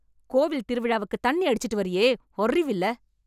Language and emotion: Tamil, angry